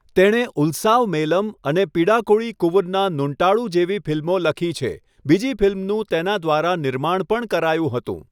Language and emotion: Gujarati, neutral